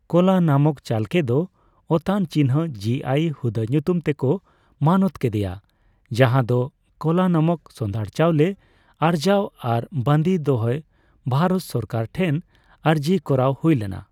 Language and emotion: Santali, neutral